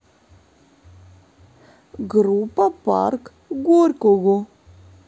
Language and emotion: Russian, neutral